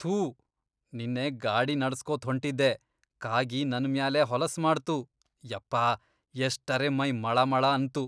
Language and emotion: Kannada, disgusted